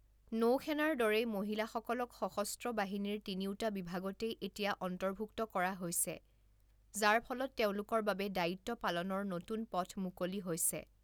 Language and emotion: Assamese, neutral